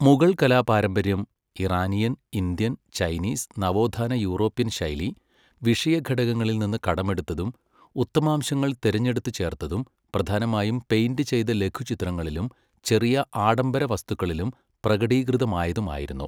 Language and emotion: Malayalam, neutral